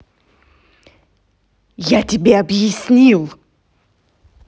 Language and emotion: Russian, angry